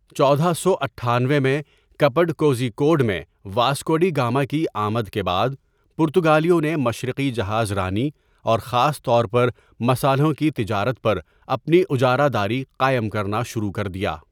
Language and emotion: Urdu, neutral